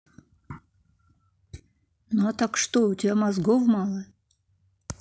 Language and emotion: Russian, angry